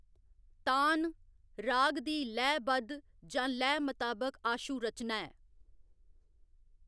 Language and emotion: Dogri, neutral